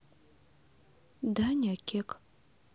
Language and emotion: Russian, neutral